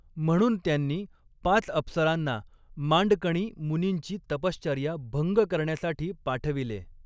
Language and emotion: Marathi, neutral